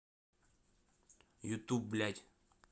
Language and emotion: Russian, angry